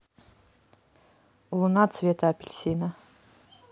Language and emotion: Russian, neutral